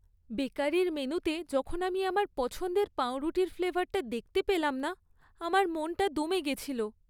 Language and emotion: Bengali, sad